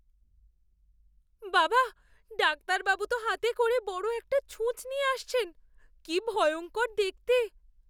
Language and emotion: Bengali, fearful